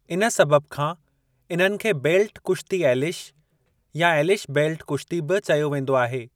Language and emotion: Sindhi, neutral